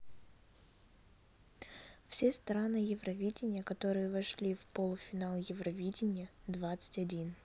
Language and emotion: Russian, neutral